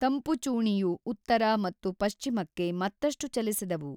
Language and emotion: Kannada, neutral